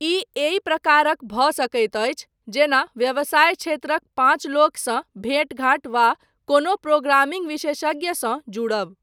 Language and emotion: Maithili, neutral